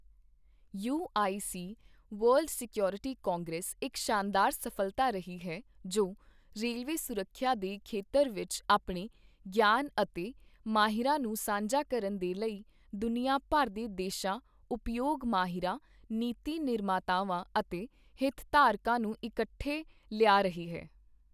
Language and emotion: Punjabi, neutral